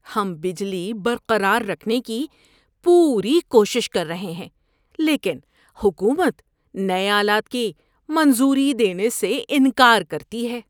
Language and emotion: Urdu, disgusted